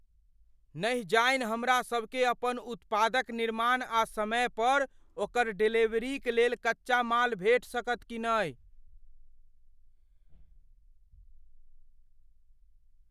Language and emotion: Maithili, fearful